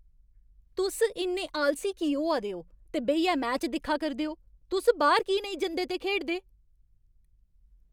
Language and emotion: Dogri, angry